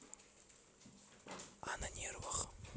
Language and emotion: Russian, neutral